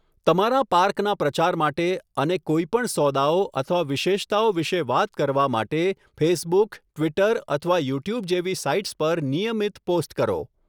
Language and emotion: Gujarati, neutral